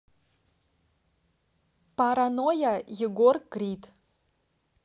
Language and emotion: Russian, neutral